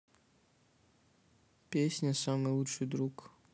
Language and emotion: Russian, neutral